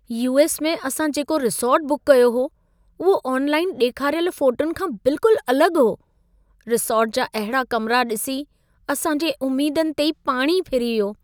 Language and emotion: Sindhi, sad